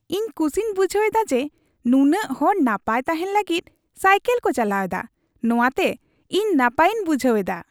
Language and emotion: Santali, happy